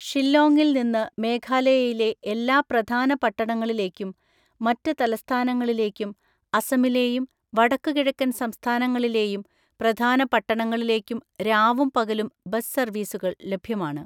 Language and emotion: Malayalam, neutral